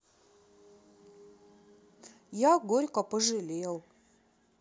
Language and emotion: Russian, sad